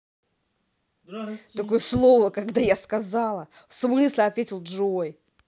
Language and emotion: Russian, angry